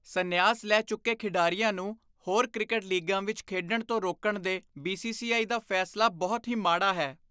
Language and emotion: Punjabi, disgusted